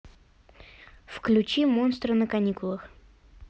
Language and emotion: Russian, neutral